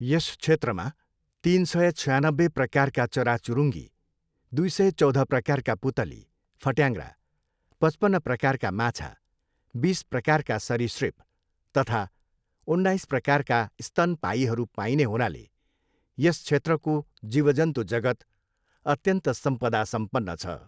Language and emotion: Nepali, neutral